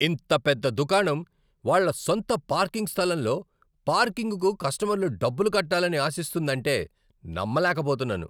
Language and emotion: Telugu, angry